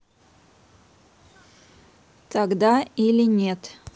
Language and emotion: Russian, neutral